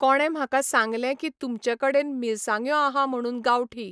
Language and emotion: Goan Konkani, neutral